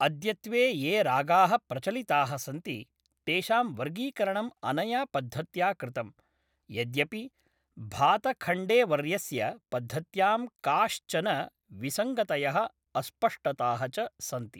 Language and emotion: Sanskrit, neutral